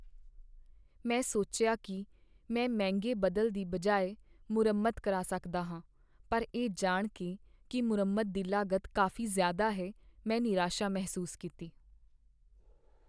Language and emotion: Punjabi, sad